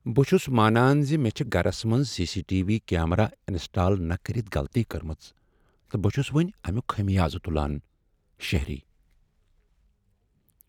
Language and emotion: Kashmiri, sad